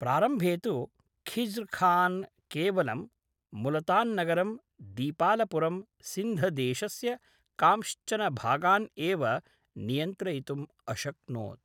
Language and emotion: Sanskrit, neutral